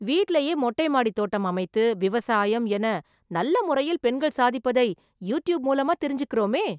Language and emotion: Tamil, surprised